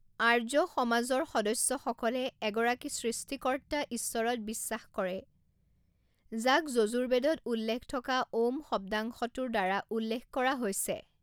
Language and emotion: Assamese, neutral